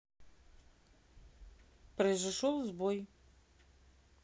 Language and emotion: Russian, neutral